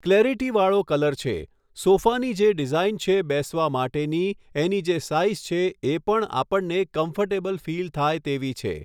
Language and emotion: Gujarati, neutral